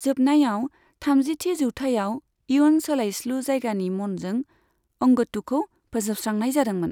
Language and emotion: Bodo, neutral